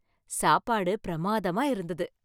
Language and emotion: Tamil, happy